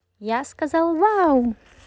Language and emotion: Russian, positive